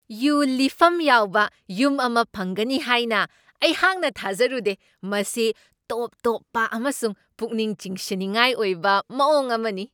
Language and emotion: Manipuri, surprised